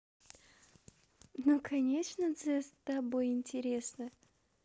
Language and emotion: Russian, positive